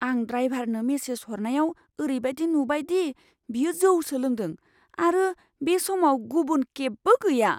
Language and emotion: Bodo, fearful